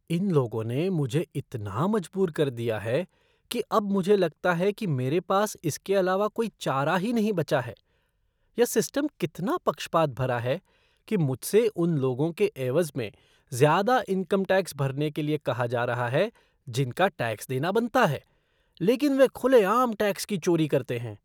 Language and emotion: Hindi, disgusted